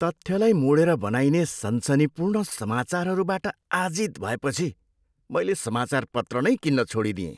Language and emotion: Nepali, disgusted